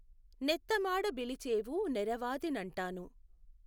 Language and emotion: Telugu, neutral